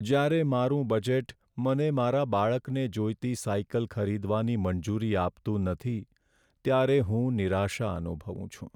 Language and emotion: Gujarati, sad